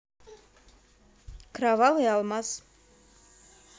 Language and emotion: Russian, neutral